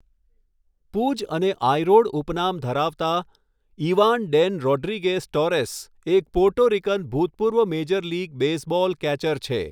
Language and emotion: Gujarati, neutral